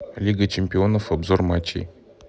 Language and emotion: Russian, neutral